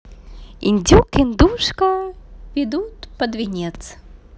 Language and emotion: Russian, positive